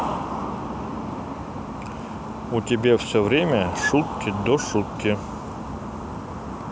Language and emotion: Russian, neutral